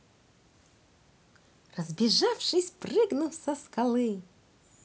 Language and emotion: Russian, positive